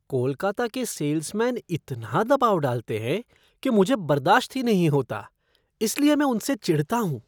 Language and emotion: Hindi, disgusted